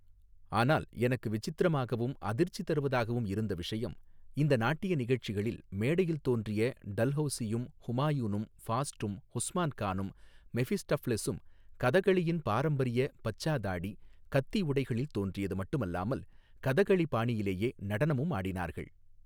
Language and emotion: Tamil, neutral